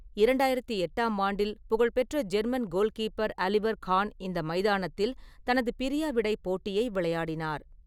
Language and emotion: Tamil, neutral